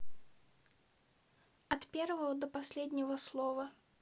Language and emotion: Russian, neutral